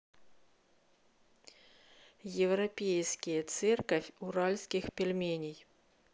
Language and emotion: Russian, neutral